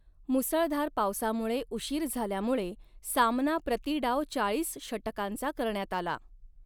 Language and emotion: Marathi, neutral